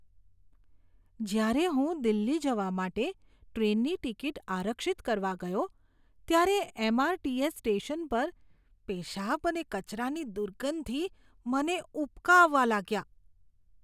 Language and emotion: Gujarati, disgusted